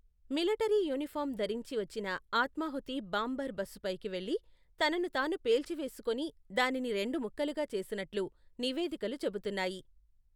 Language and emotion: Telugu, neutral